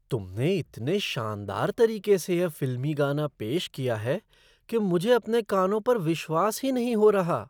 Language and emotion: Hindi, surprised